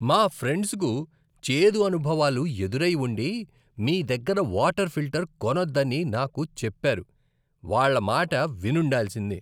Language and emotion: Telugu, disgusted